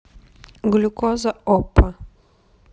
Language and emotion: Russian, neutral